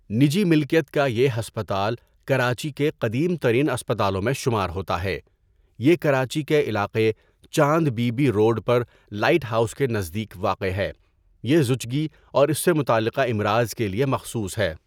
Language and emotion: Urdu, neutral